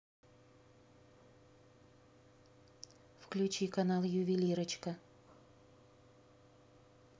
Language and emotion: Russian, neutral